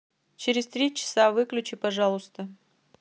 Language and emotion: Russian, neutral